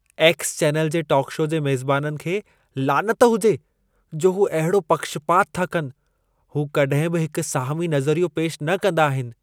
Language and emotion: Sindhi, disgusted